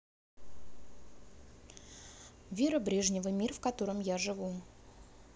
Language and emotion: Russian, neutral